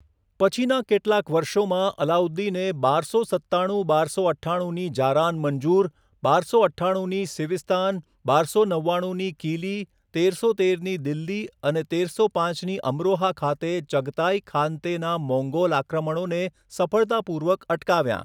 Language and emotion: Gujarati, neutral